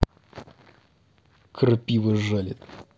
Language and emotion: Russian, angry